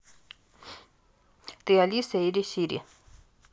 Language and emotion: Russian, neutral